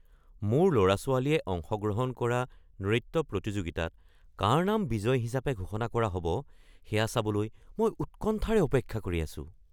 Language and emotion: Assamese, surprised